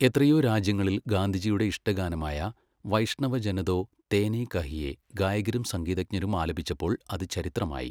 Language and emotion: Malayalam, neutral